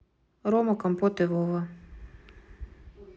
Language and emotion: Russian, neutral